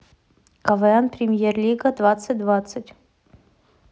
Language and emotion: Russian, neutral